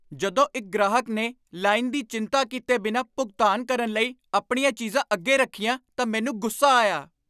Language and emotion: Punjabi, angry